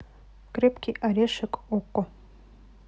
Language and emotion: Russian, neutral